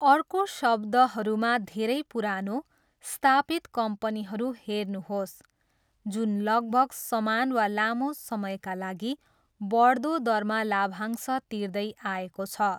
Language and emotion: Nepali, neutral